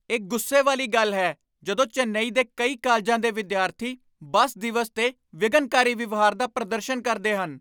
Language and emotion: Punjabi, angry